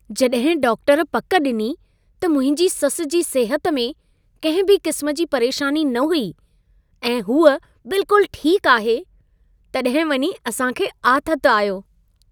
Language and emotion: Sindhi, happy